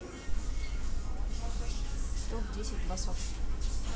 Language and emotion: Russian, neutral